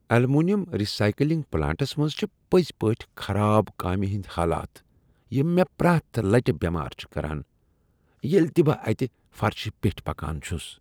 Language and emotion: Kashmiri, disgusted